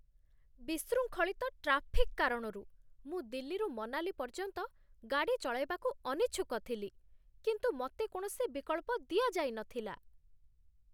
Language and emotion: Odia, disgusted